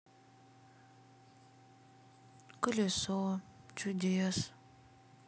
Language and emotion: Russian, sad